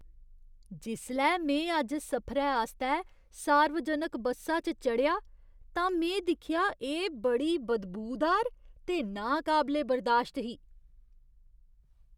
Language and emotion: Dogri, disgusted